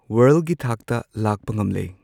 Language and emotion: Manipuri, neutral